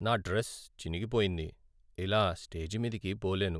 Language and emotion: Telugu, sad